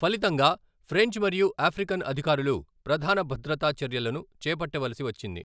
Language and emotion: Telugu, neutral